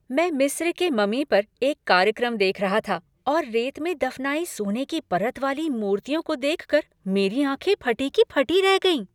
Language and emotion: Hindi, happy